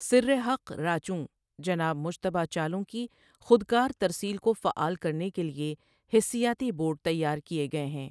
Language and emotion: Urdu, neutral